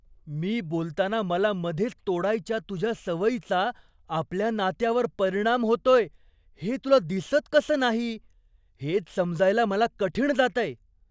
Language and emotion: Marathi, surprised